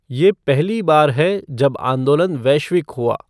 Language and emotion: Hindi, neutral